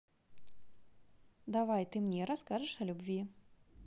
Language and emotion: Russian, positive